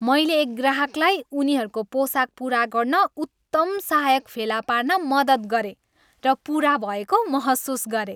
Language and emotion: Nepali, happy